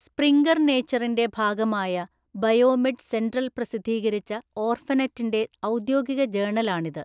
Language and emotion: Malayalam, neutral